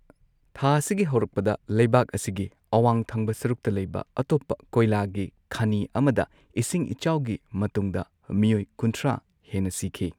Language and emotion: Manipuri, neutral